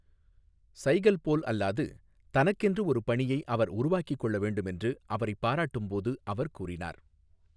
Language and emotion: Tamil, neutral